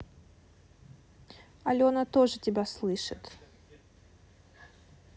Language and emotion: Russian, neutral